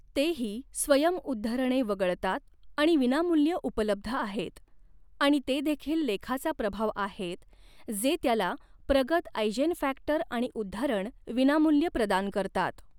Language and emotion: Marathi, neutral